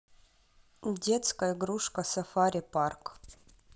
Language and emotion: Russian, neutral